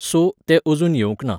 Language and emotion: Goan Konkani, neutral